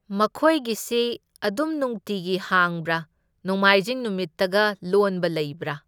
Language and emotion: Manipuri, neutral